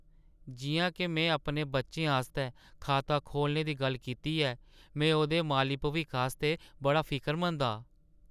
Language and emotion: Dogri, sad